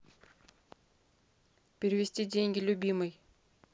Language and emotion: Russian, neutral